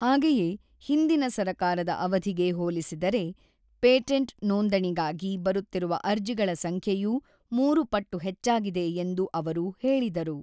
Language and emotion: Kannada, neutral